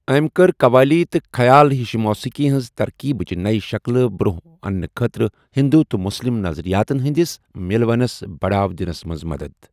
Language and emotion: Kashmiri, neutral